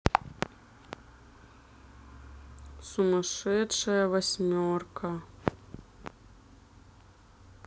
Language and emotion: Russian, sad